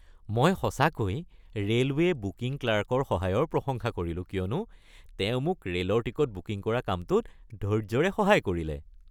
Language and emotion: Assamese, happy